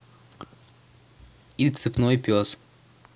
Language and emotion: Russian, neutral